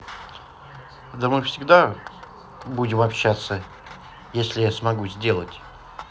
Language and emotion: Russian, neutral